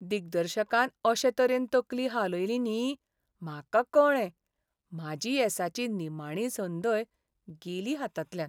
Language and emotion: Goan Konkani, sad